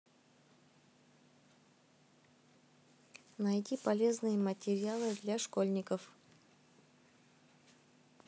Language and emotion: Russian, neutral